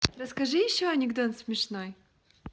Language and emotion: Russian, positive